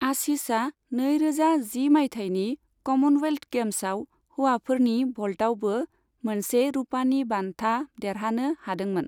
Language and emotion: Bodo, neutral